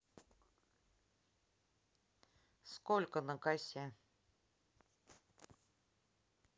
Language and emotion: Russian, neutral